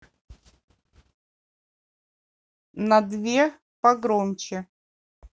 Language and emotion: Russian, neutral